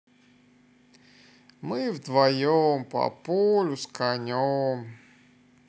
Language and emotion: Russian, sad